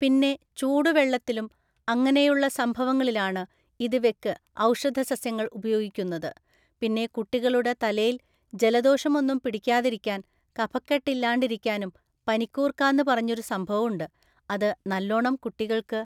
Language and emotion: Malayalam, neutral